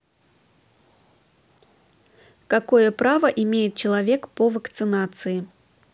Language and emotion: Russian, positive